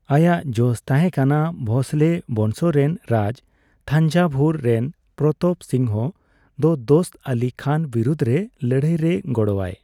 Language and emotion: Santali, neutral